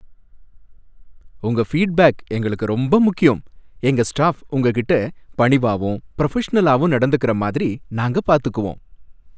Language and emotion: Tamil, happy